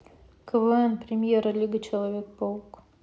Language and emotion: Russian, neutral